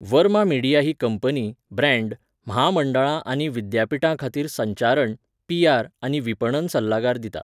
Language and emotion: Goan Konkani, neutral